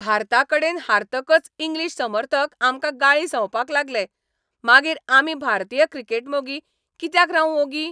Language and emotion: Goan Konkani, angry